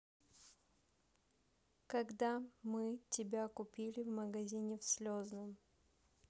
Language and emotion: Russian, neutral